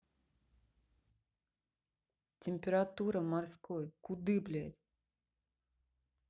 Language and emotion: Russian, angry